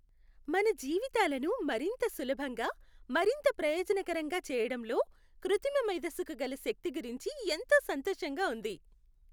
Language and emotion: Telugu, happy